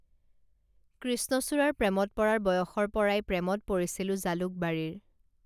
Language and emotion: Assamese, neutral